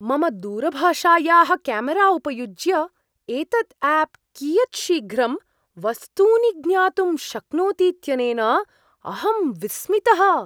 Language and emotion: Sanskrit, surprised